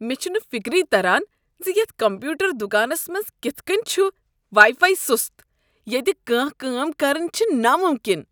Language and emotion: Kashmiri, disgusted